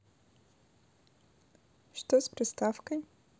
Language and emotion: Russian, neutral